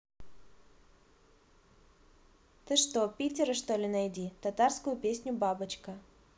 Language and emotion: Russian, neutral